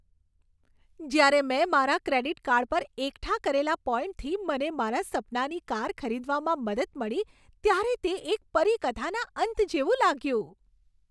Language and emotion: Gujarati, happy